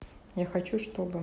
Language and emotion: Russian, neutral